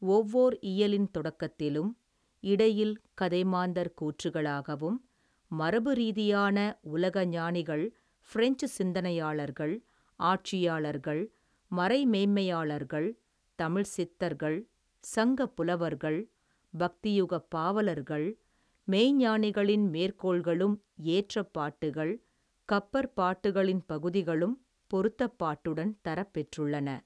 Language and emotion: Tamil, neutral